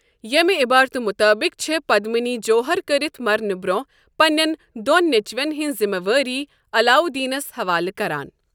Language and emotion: Kashmiri, neutral